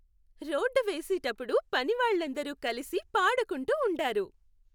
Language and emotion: Telugu, happy